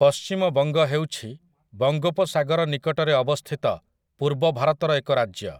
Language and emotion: Odia, neutral